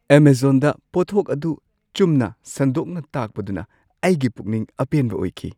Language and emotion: Manipuri, surprised